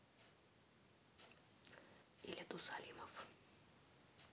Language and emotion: Russian, neutral